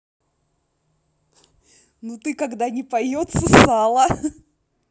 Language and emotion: Russian, positive